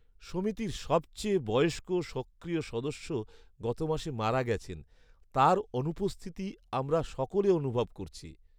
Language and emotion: Bengali, sad